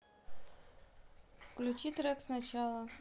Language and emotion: Russian, neutral